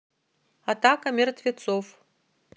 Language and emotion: Russian, neutral